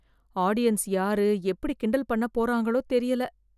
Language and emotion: Tamil, fearful